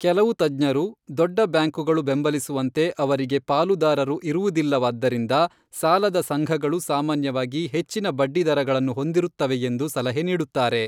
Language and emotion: Kannada, neutral